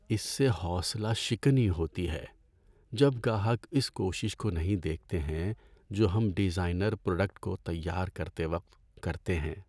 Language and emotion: Urdu, sad